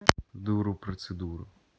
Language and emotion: Russian, neutral